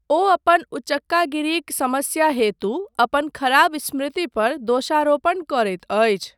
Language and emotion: Maithili, neutral